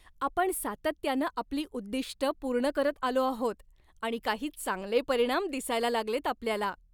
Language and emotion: Marathi, happy